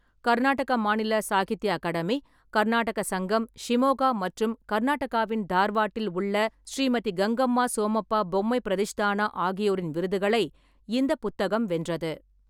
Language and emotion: Tamil, neutral